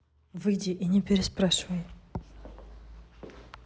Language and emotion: Russian, neutral